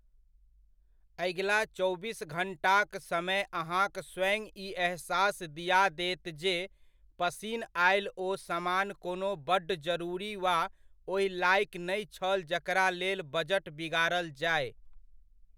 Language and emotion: Maithili, neutral